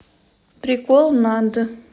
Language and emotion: Russian, neutral